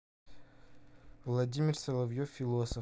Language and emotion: Russian, neutral